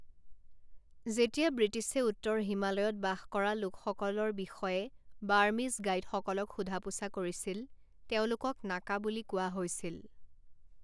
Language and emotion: Assamese, neutral